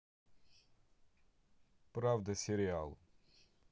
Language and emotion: Russian, neutral